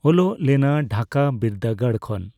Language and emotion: Santali, neutral